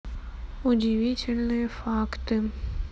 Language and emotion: Russian, neutral